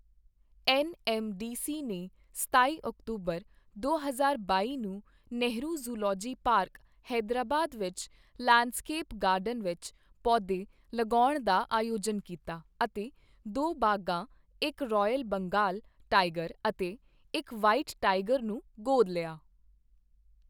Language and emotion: Punjabi, neutral